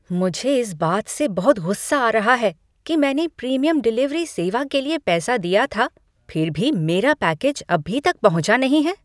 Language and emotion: Hindi, angry